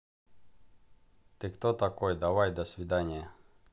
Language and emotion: Russian, neutral